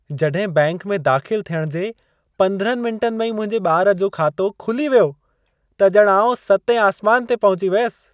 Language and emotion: Sindhi, happy